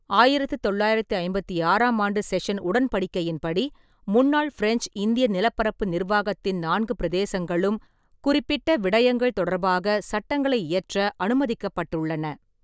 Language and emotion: Tamil, neutral